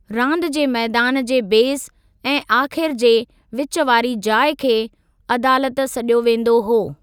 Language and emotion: Sindhi, neutral